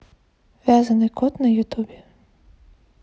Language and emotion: Russian, neutral